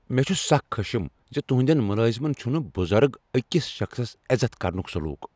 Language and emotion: Kashmiri, angry